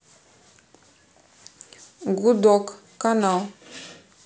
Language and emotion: Russian, neutral